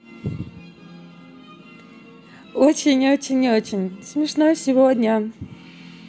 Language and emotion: Russian, positive